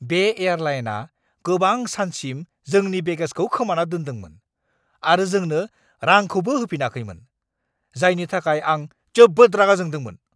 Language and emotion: Bodo, angry